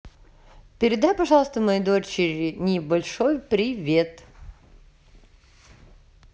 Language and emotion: Russian, positive